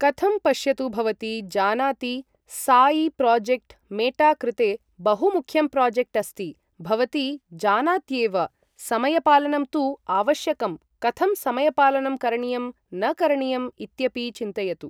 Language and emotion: Sanskrit, neutral